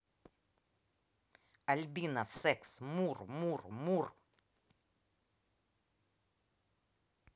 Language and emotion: Russian, angry